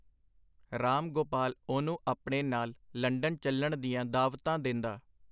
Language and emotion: Punjabi, neutral